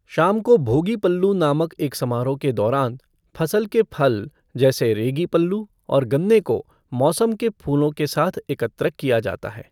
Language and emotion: Hindi, neutral